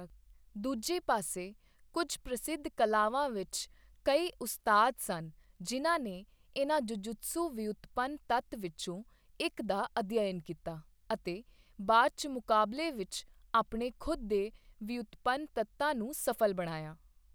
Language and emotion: Punjabi, neutral